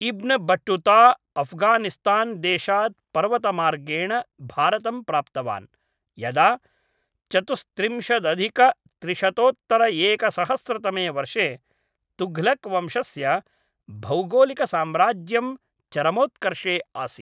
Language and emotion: Sanskrit, neutral